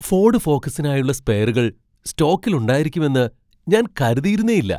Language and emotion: Malayalam, surprised